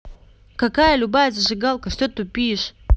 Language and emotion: Russian, angry